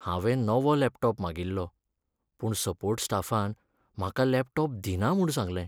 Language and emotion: Goan Konkani, sad